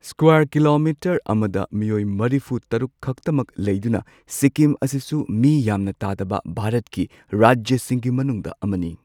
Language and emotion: Manipuri, neutral